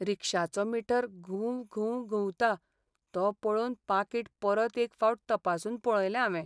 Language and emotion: Goan Konkani, sad